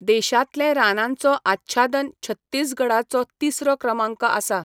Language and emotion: Goan Konkani, neutral